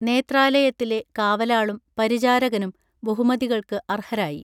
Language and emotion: Malayalam, neutral